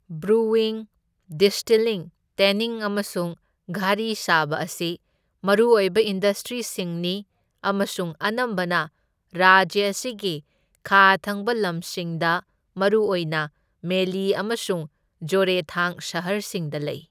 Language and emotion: Manipuri, neutral